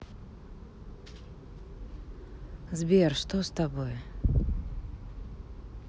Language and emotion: Russian, sad